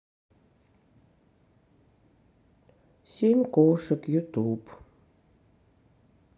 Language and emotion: Russian, sad